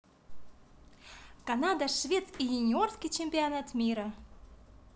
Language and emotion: Russian, positive